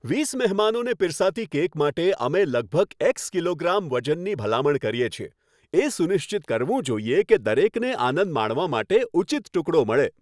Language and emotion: Gujarati, happy